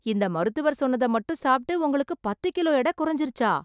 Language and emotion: Tamil, surprised